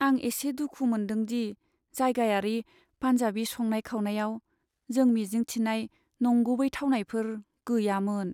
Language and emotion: Bodo, sad